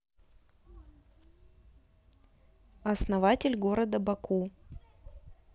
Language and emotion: Russian, neutral